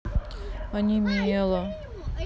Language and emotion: Russian, sad